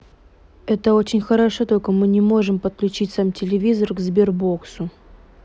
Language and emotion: Russian, neutral